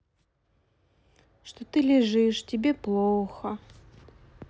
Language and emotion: Russian, sad